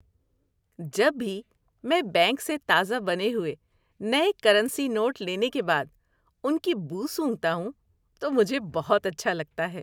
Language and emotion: Urdu, happy